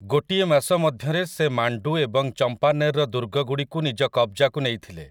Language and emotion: Odia, neutral